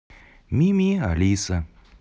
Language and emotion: Russian, neutral